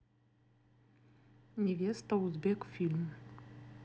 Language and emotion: Russian, neutral